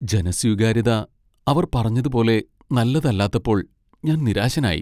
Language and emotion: Malayalam, sad